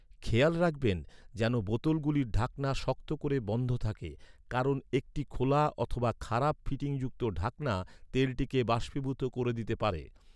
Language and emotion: Bengali, neutral